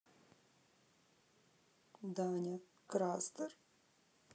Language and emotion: Russian, sad